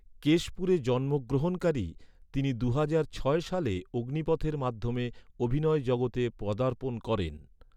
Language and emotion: Bengali, neutral